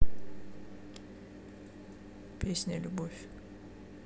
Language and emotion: Russian, neutral